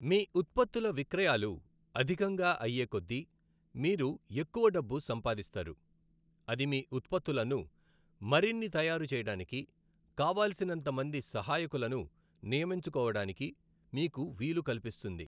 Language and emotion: Telugu, neutral